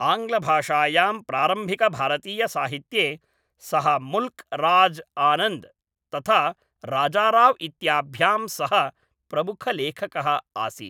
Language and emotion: Sanskrit, neutral